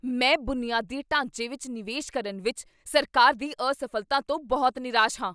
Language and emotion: Punjabi, angry